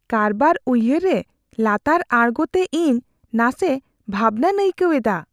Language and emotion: Santali, fearful